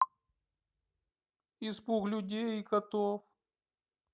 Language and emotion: Russian, sad